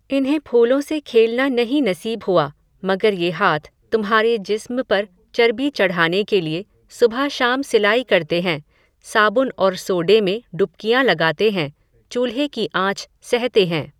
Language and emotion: Hindi, neutral